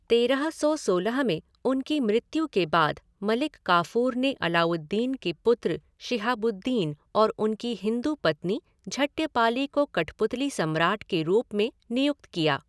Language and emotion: Hindi, neutral